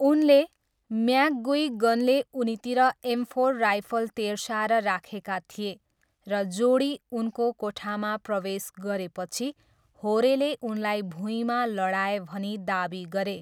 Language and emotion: Nepali, neutral